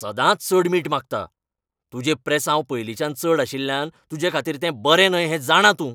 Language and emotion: Goan Konkani, angry